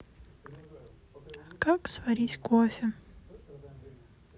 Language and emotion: Russian, sad